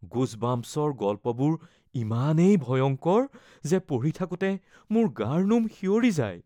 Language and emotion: Assamese, fearful